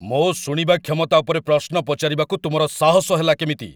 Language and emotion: Odia, angry